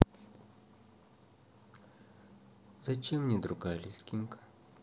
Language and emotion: Russian, sad